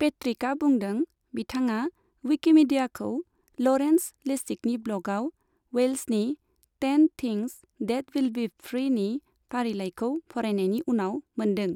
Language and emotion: Bodo, neutral